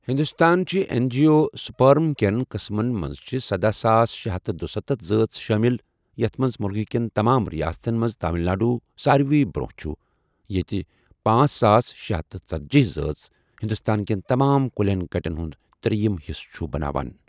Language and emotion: Kashmiri, neutral